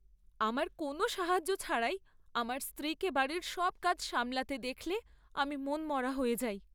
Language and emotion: Bengali, sad